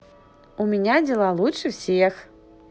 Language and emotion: Russian, positive